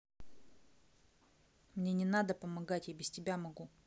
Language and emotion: Russian, angry